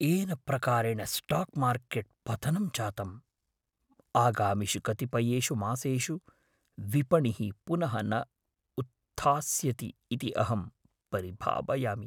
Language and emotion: Sanskrit, fearful